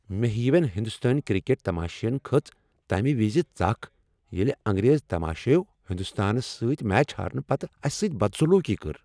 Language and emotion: Kashmiri, angry